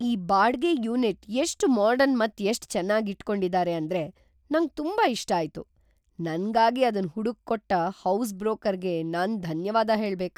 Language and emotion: Kannada, surprised